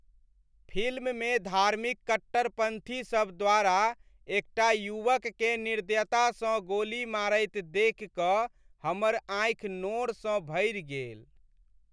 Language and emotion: Maithili, sad